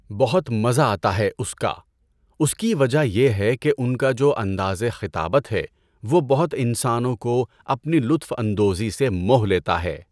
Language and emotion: Urdu, neutral